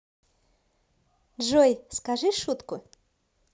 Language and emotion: Russian, positive